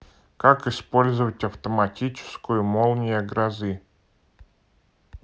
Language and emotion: Russian, neutral